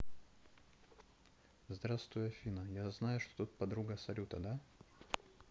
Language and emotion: Russian, neutral